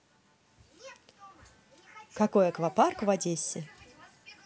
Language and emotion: Russian, positive